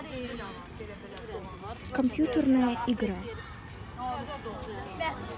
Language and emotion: Russian, neutral